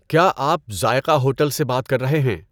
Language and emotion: Urdu, neutral